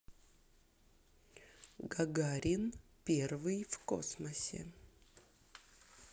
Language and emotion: Russian, neutral